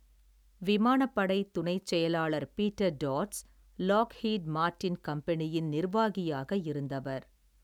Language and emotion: Tamil, neutral